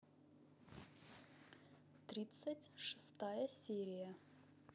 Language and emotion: Russian, neutral